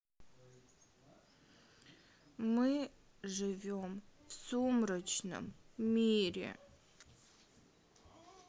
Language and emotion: Russian, sad